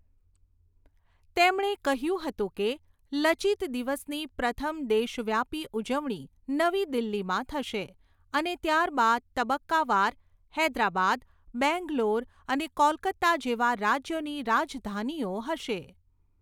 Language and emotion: Gujarati, neutral